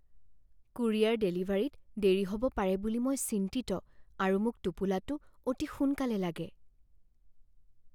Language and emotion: Assamese, fearful